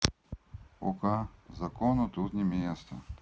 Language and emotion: Russian, neutral